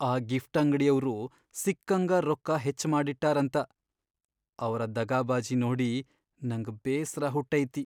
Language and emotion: Kannada, sad